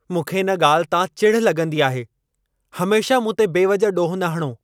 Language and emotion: Sindhi, angry